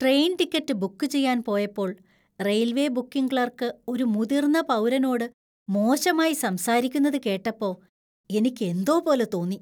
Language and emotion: Malayalam, disgusted